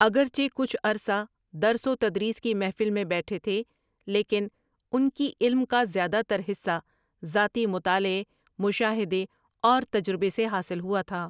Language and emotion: Urdu, neutral